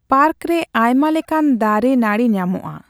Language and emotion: Santali, neutral